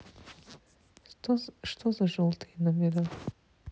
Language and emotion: Russian, neutral